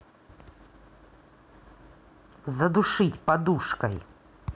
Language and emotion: Russian, angry